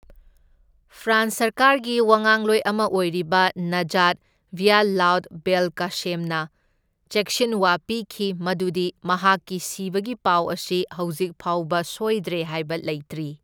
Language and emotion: Manipuri, neutral